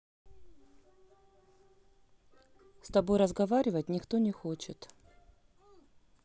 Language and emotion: Russian, neutral